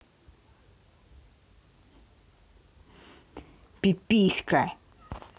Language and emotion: Russian, angry